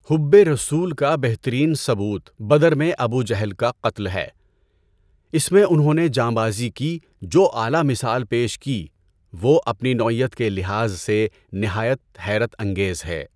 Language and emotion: Urdu, neutral